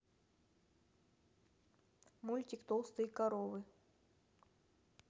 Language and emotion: Russian, neutral